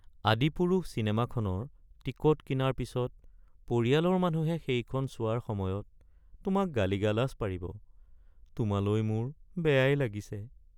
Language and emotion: Assamese, sad